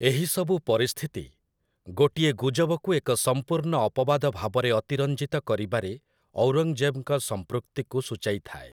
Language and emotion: Odia, neutral